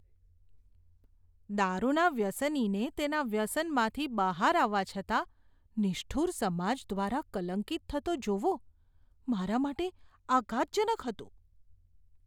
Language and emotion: Gujarati, disgusted